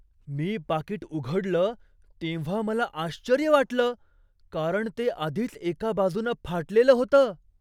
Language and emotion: Marathi, surprised